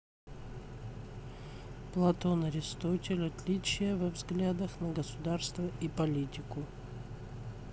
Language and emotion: Russian, neutral